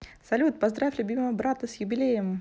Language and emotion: Russian, positive